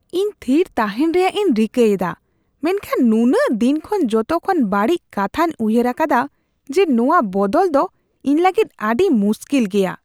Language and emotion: Santali, disgusted